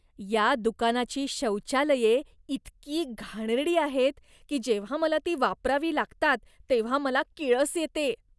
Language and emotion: Marathi, disgusted